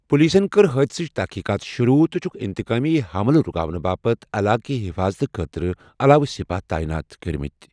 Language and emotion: Kashmiri, neutral